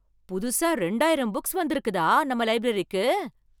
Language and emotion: Tamil, surprised